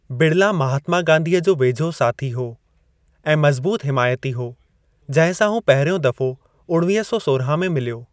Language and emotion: Sindhi, neutral